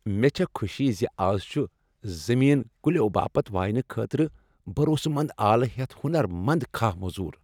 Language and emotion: Kashmiri, happy